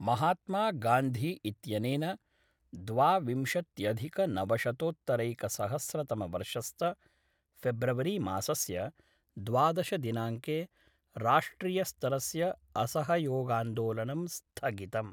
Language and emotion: Sanskrit, neutral